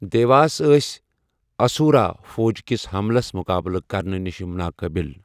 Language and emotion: Kashmiri, neutral